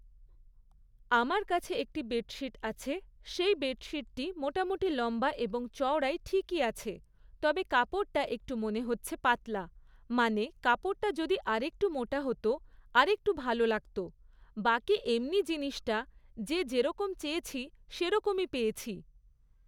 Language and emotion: Bengali, neutral